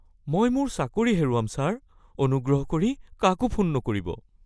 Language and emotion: Assamese, fearful